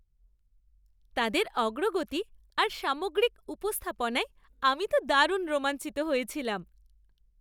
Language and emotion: Bengali, happy